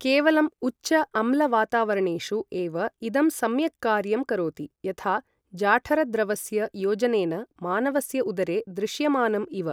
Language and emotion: Sanskrit, neutral